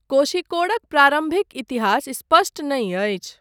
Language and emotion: Maithili, neutral